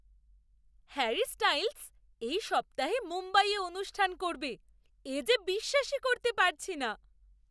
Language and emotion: Bengali, surprised